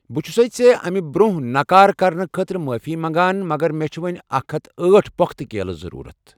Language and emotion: Kashmiri, neutral